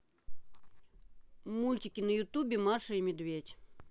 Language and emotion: Russian, neutral